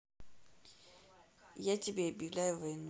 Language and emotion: Russian, neutral